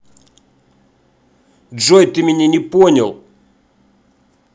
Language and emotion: Russian, angry